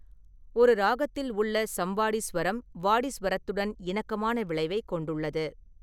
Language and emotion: Tamil, neutral